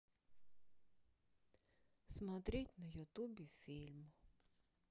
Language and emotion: Russian, sad